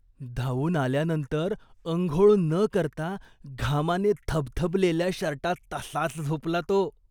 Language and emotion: Marathi, disgusted